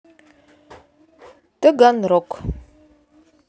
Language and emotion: Russian, neutral